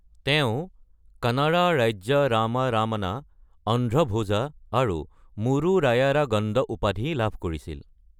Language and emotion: Assamese, neutral